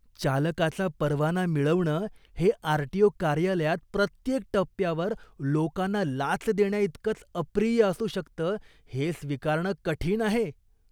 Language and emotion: Marathi, disgusted